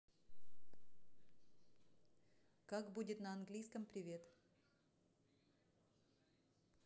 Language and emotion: Russian, neutral